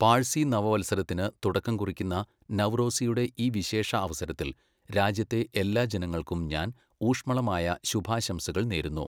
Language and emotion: Malayalam, neutral